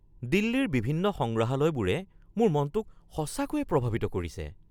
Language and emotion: Assamese, surprised